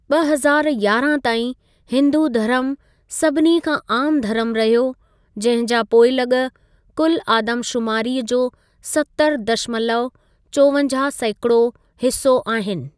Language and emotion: Sindhi, neutral